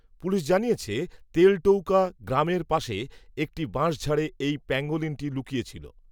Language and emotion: Bengali, neutral